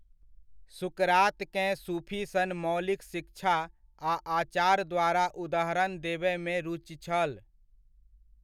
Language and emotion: Maithili, neutral